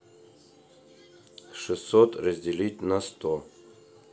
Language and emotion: Russian, neutral